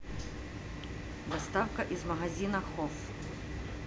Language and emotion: Russian, neutral